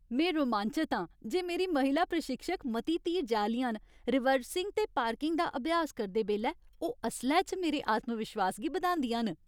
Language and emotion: Dogri, happy